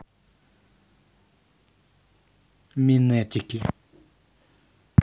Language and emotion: Russian, neutral